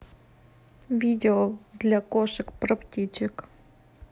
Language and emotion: Russian, neutral